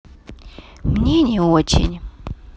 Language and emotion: Russian, neutral